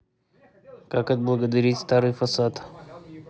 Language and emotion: Russian, neutral